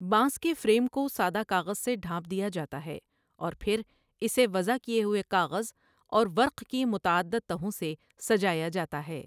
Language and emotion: Urdu, neutral